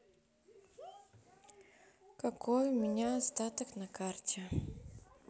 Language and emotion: Russian, neutral